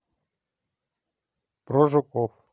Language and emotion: Russian, neutral